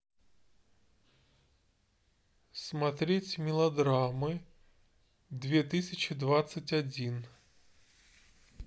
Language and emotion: Russian, neutral